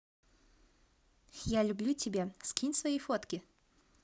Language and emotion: Russian, positive